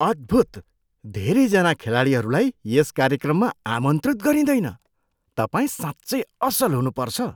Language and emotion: Nepali, surprised